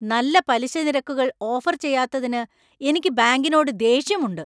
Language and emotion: Malayalam, angry